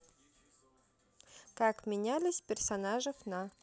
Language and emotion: Russian, neutral